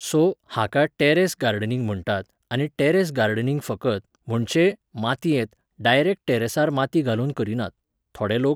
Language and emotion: Goan Konkani, neutral